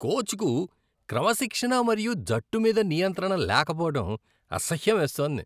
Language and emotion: Telugu, disgusted